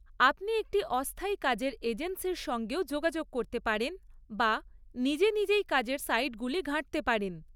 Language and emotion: Bengali, neutral